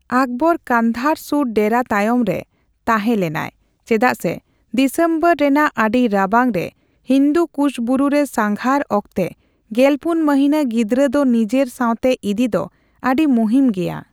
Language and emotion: Santali, neutral